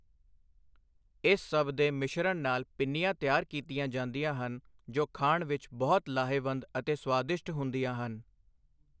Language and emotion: Punjabi, neutral